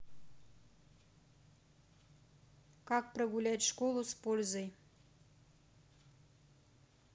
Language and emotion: Russian, neutral